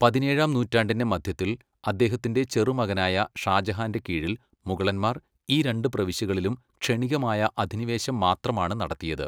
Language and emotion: Malayalam, neutral